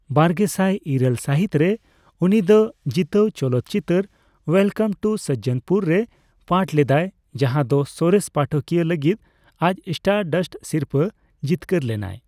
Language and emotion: Santali, neutral